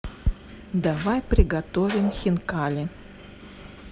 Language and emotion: Russian, neutral